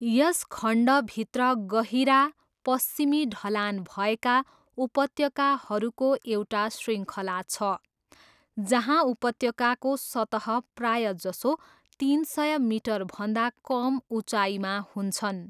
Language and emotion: Nepali, neutral